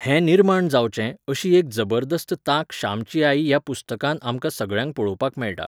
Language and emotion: Goan Konkani, neutral